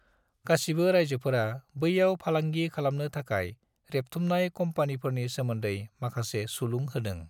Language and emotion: Bodo, neutral